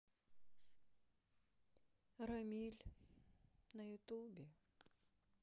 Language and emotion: Russian, sad